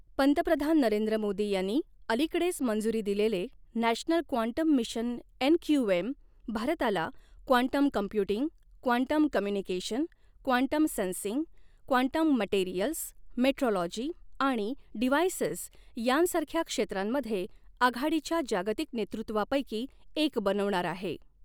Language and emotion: Marathi, neutral